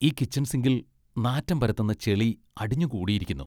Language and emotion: Malayalam, disgusted